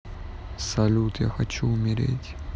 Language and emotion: Russian, sad